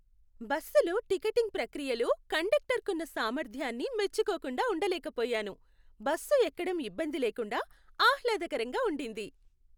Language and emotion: Telugu, happy